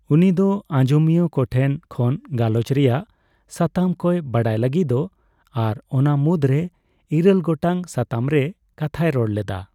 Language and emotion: Santali, neutral